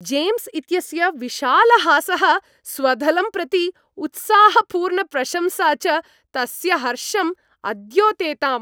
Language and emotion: Sanskrit, happy